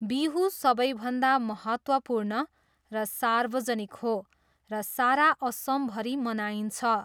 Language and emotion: Nepali, neutral